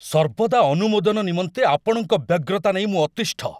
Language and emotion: Odia, angry